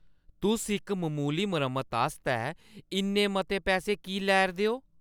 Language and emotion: Dogri, angry